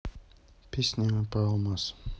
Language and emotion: Russian, neutral